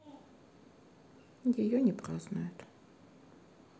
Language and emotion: Russian, sad